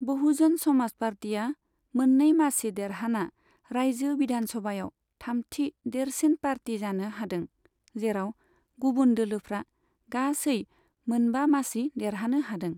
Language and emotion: Bodo, neutral